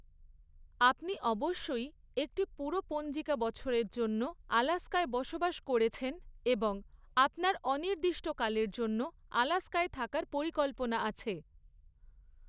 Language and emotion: Bengali, neutral